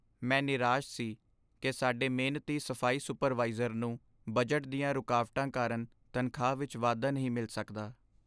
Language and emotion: Punjabi, sad